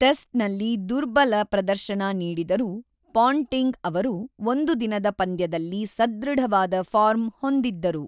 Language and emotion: Kannada, neutral